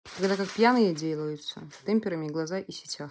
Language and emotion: Russian, neutral